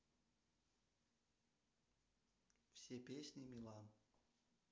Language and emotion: Russian, neutral